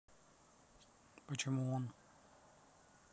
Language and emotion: Russian, neutral